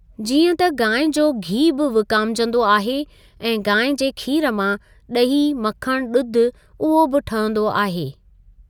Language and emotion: Sindhi, neutral